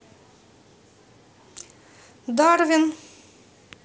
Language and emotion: Russian, neutral